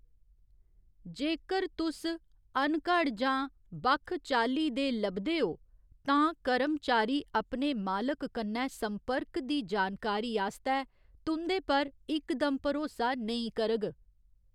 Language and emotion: Dogri, neutral